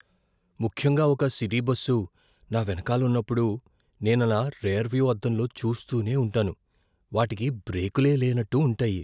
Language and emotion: Telugu, fearful